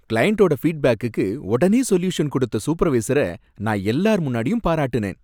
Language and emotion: Tamil, happy